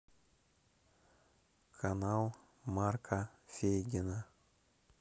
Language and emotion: Russian, neutral